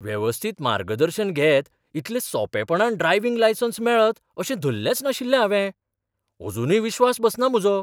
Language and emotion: Goan Konkani, surprised